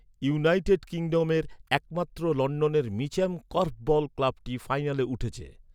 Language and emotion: Bengali, neutral